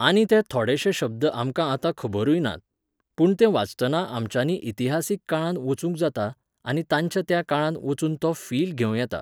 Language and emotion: Goan Konkani, neutral